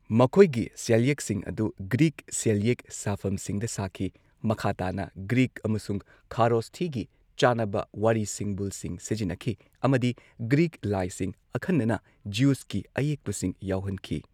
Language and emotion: Manipuri, neutral